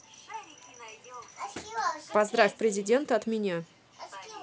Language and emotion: Russian, neutral